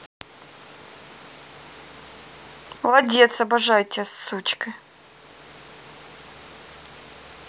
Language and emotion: Russian, positive